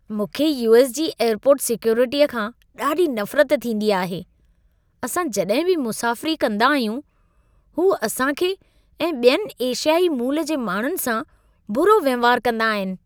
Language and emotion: Sindhi, disgusted